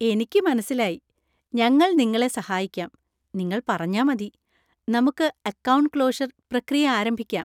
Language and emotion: Malayalam, happy